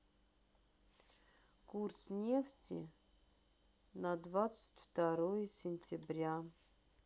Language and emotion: Russian, sad